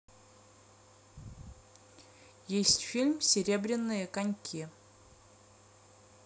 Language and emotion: Russian, neutral